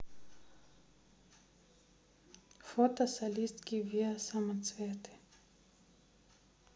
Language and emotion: Russian, neutral